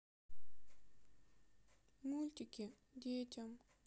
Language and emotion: Russian, sad